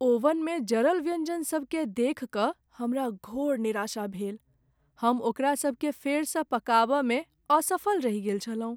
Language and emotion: Maithili, sad